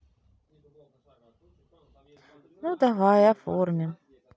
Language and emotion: Russian, sad